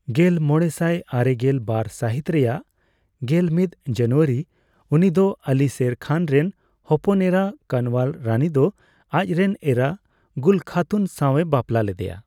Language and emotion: Santali, neutral